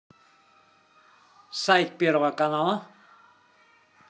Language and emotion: Russian, positive